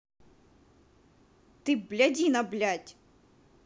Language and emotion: Russian, angry